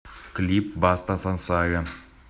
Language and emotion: Russian, neutral